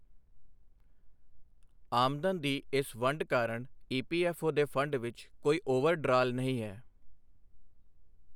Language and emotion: Punjabi, neutral